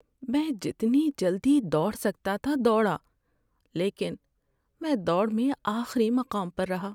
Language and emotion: Urdu, sad